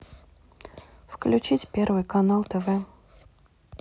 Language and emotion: Russian, neutral